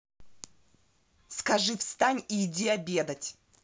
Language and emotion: Russian, angry